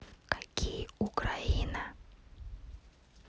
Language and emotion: Russian, neutral